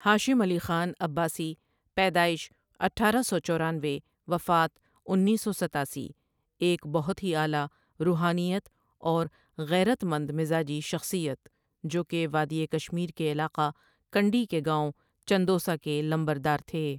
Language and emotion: Urdu, neutral